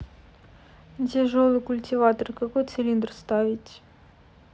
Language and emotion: Russian, sad